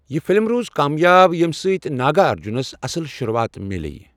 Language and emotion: Kashmiri, neutral